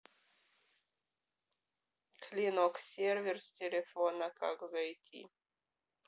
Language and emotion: Russian, neutral